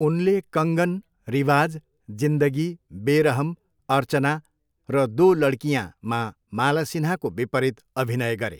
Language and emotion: Nepali, neutral